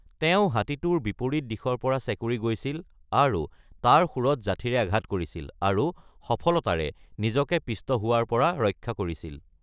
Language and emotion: Assamese, neutral